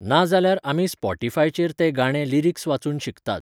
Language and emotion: Goan Konkani, neutral